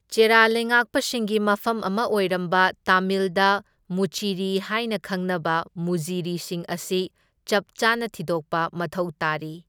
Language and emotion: Manipuri, neutral